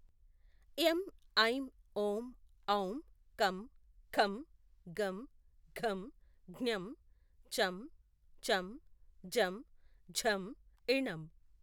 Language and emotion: Telugu, neutral